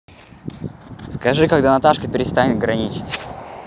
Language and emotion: Russian, neutral